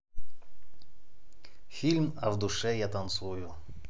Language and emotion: Russian, neutral